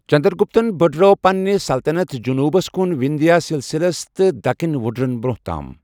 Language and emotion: Kashmiri, neutral